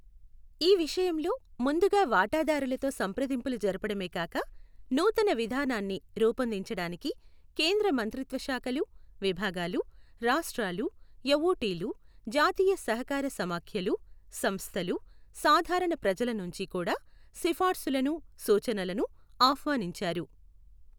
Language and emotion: Telugu, neutral